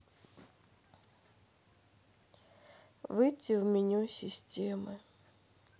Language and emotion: Russian, sad